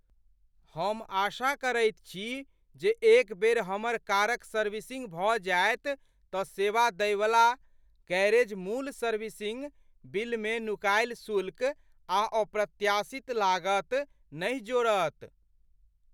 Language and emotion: Maithili, fearful